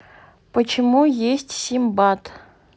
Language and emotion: Russian, neutral